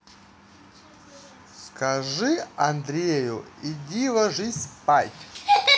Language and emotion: Russian, neutral